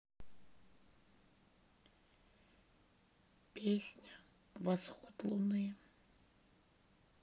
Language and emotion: Russian, sad